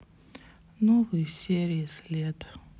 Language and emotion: Russian, sad